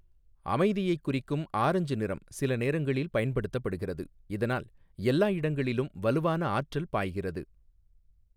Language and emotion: Tamil, neutral